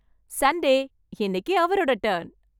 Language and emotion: Tamil, happy